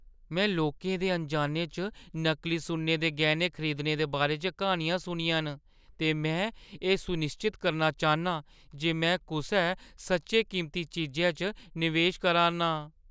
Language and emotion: Dogri, fearful